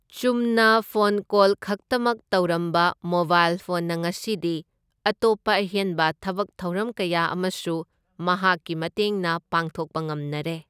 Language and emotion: Manipuri, neutral